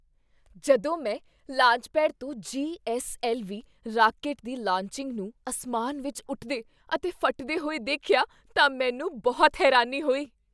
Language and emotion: Punjabi, surprised